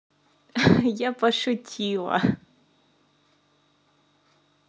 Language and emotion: Russian, positive